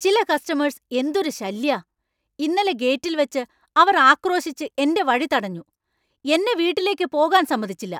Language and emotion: Malayalam, angry